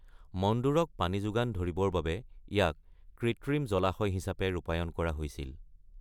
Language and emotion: Assamese, neutral